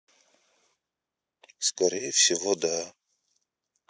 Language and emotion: Russian, sad